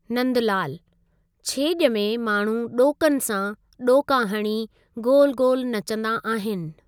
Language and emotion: Sindhi, neutral